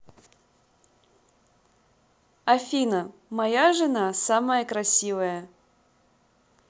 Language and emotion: Russian, positive